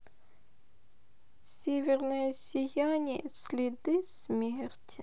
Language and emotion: Russian, sad